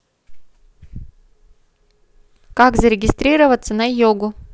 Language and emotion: Russian, neutral